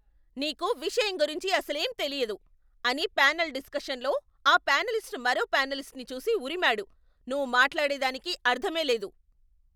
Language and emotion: Telugu, angry